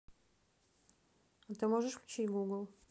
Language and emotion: Russian, neutral